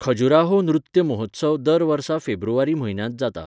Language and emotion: Goan Konkani, neutral